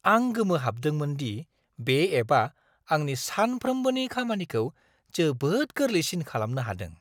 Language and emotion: Bodo, surprised